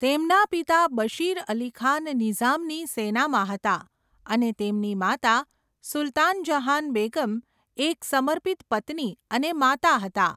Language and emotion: Gujarati, neutral